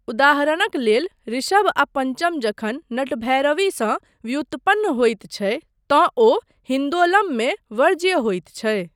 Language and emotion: Maithili, neutral